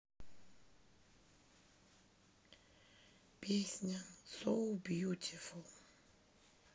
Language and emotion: Russian, sad